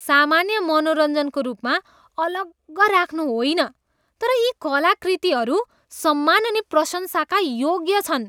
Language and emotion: Nepali, disgusted